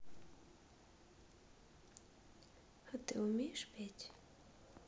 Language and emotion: Russian, neutral